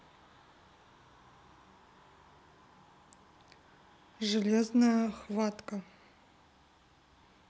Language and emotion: Russian, neutral